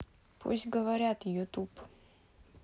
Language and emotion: Russian, neutral